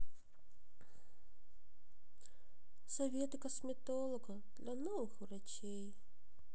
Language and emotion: Russian, sad